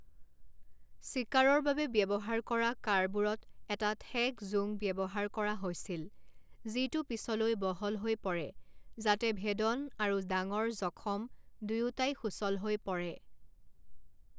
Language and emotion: Assamese, neutral